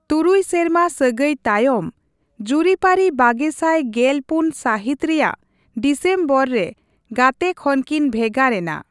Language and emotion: Santali, neutral